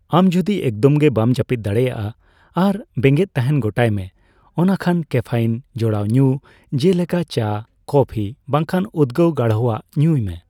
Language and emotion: Santali, neutral